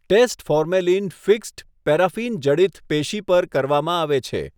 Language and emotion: Gujarati, neutral